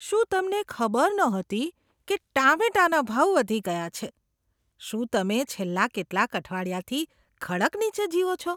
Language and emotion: Gujarati, disgusted